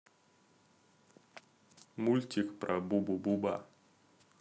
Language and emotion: Russian, neutral